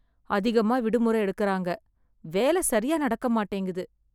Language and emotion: Tamil, sad